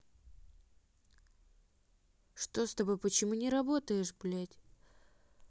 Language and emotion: Russian, angry